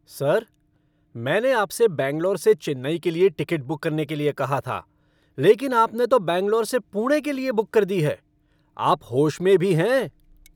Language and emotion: Hindi, angry